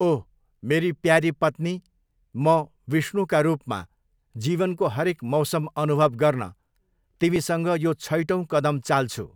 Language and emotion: Nepali, neutral